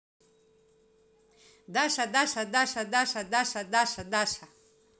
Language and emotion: Russian, positive